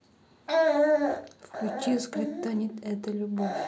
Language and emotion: Russian, neutral